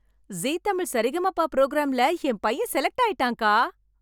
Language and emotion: Tamil, happy